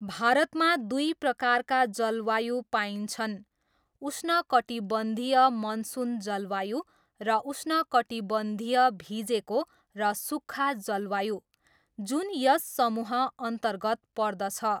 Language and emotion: Nepali, neutral